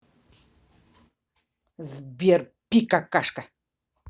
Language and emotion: Russian, angry